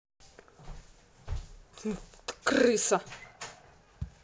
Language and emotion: Russian, angry